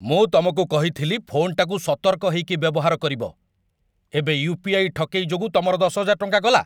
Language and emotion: Odia, angry